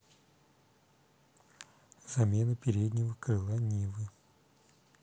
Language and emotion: Russian, neutral